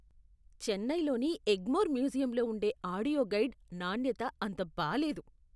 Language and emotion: Telugu, disgusted